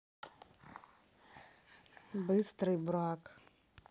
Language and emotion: Russian, neutral